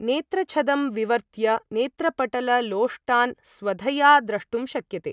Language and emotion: Sanskrit, neutral